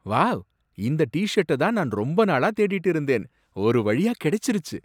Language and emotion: Tamil, surprised